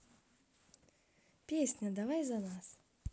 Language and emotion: Russian, positive